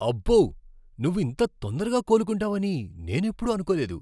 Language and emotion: Telugu, surprised